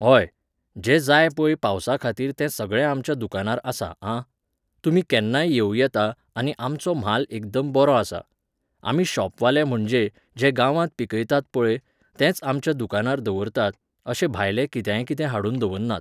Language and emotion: Goan Konkani, neutral